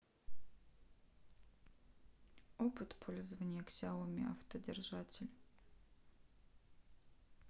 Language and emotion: Russian, neutral